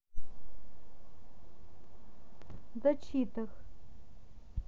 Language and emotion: Russian, neutral